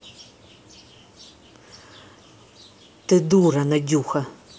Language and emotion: Russian, angry